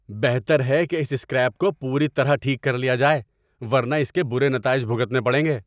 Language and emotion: Urdu, angry